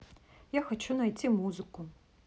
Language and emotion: Russian, neutral